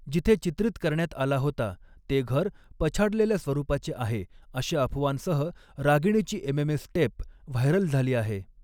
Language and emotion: Marathi, neutral